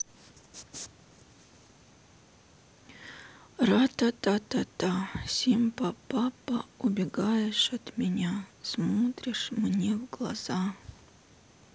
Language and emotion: Russian, sad